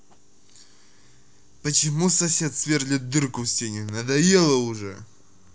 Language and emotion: Russian, angry